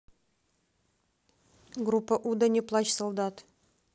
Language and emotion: Russian, neutral